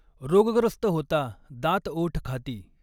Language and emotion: Marathi, neutral